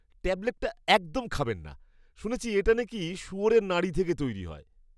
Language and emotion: Bengali, disgusted